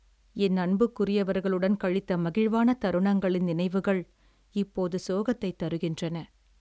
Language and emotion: Tamil, sad